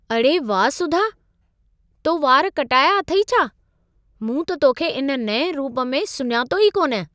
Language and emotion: Sindhi, surprised